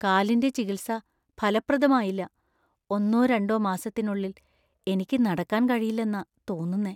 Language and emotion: Malayalam, fearful